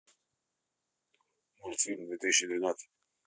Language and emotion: Russian, neutral